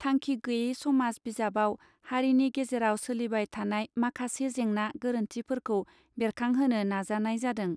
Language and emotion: Bodo, neutral